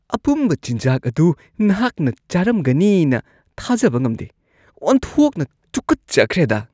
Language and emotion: Manipuri, disgusted